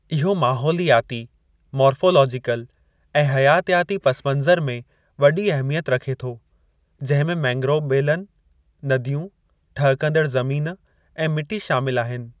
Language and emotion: Sindhi, neutral